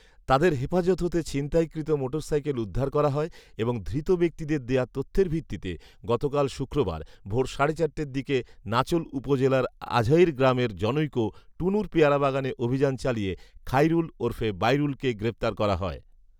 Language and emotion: Bengali, neutral